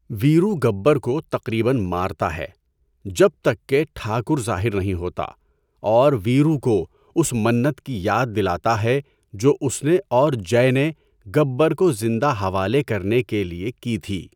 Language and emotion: Urdu, neutral